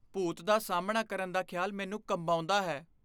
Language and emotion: Punjabi, fearful